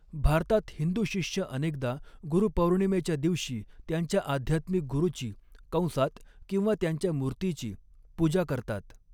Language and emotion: Marathi, neutral